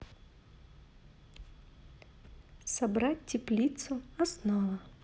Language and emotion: Russian, neutral